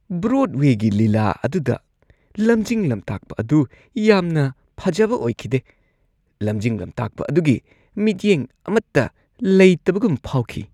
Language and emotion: Manipuri, disgusted